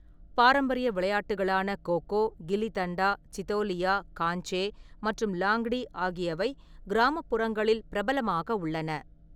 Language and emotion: Tamil, neutral